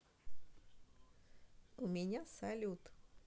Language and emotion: Russian, positive